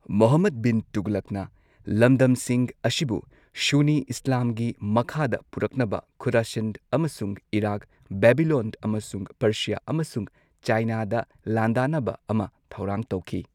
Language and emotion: Manipuri, neutral